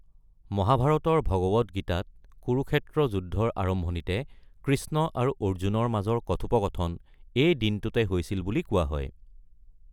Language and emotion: Assamese, neutral